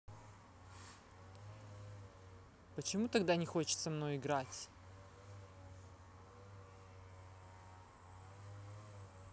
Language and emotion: Russian, angry